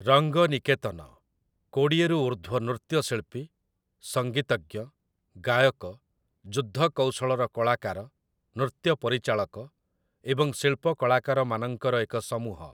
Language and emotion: Odia, neutral